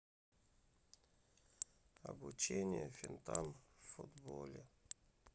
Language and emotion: Russian, sad